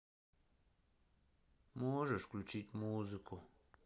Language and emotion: Russian, sad